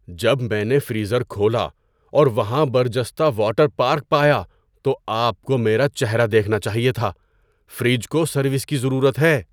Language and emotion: Urdu, surprised